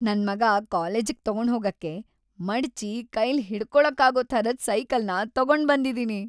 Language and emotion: Kannada, happy